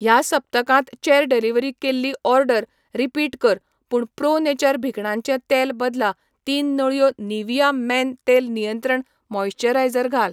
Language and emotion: Goan Konkani, neutral